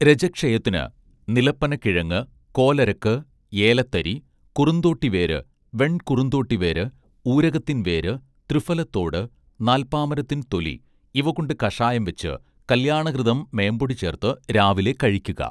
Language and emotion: Malayalam, neutral